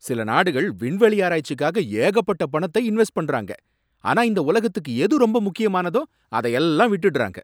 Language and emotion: Tamil, angry